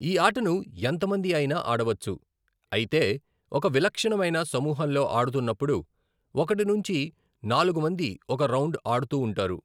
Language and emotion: Telugu, neutral